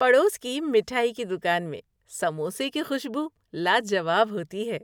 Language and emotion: Urdu, happy